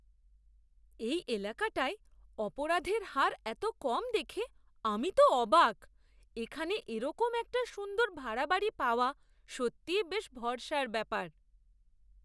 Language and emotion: Bengali, surprised